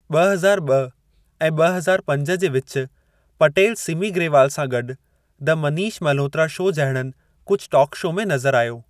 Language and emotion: Sindhi, neutral